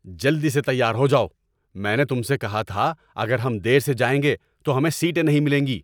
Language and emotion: Urdu, angry